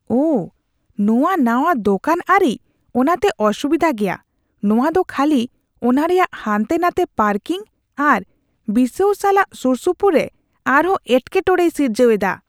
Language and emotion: Santali, disgusted